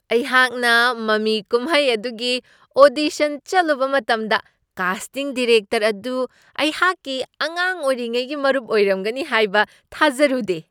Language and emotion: Manipuri, surprised